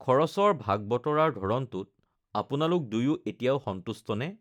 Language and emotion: Assamese, neutral